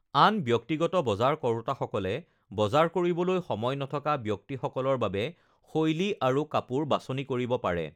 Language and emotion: Assamese, neutral